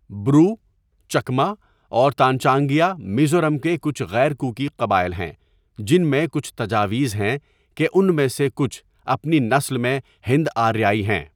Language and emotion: Urdu, neutral